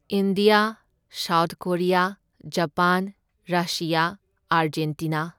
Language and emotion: Manipuri, neutral